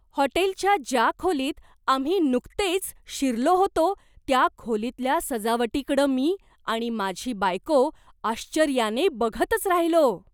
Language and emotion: Marathi, surprised